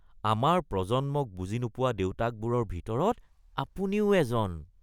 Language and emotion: Assamese, disgusted